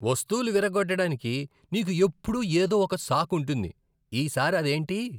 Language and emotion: Telugu, disgusted